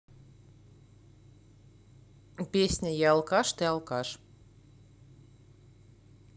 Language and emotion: Russian, neutral